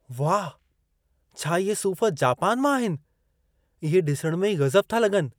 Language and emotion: Sindhi, surprised